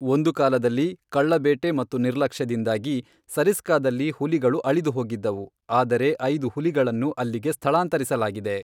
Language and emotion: Kannada, neutral